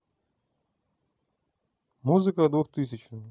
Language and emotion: Russian, neutral